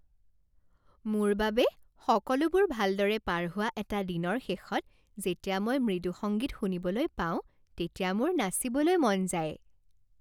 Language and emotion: Assamese, happy